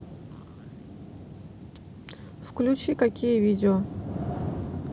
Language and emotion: Russian, neutral